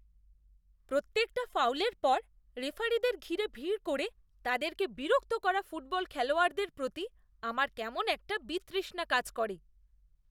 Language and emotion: Bengali, disgusted